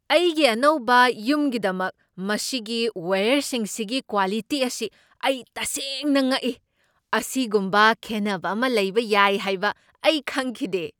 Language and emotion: Manipuri, surprised